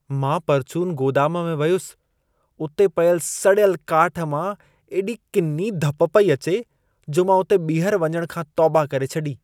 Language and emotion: Sindhi, disgusted